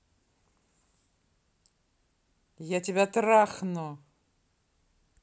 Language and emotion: Russian, angry